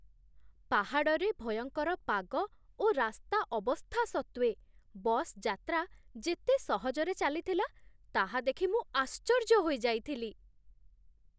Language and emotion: Odia, surprised